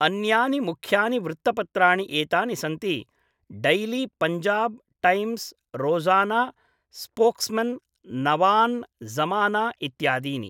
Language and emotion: Sanskrit, neutral